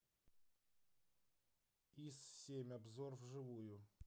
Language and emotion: Russian, neutral